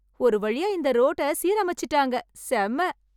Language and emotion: Tamil, happy